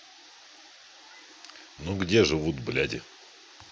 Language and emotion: Russian, neutral